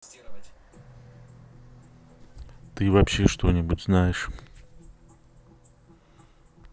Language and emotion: Russian, neutral